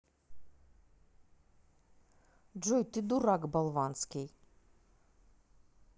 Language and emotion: Russian, angry